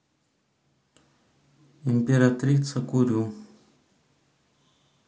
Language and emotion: Russian, neutral